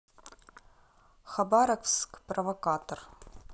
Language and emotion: Russian, neutral